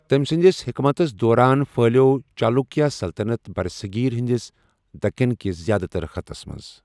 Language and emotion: Kashmiri, neutral